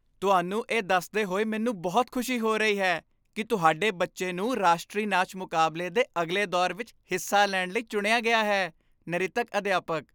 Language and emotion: Punjabi, happy